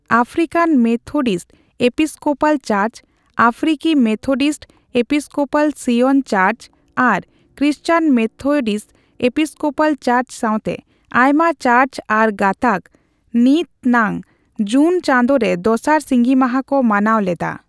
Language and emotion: Santali, neutral